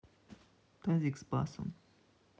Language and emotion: Russian, neutral